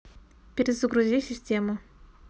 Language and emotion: Russian, neutral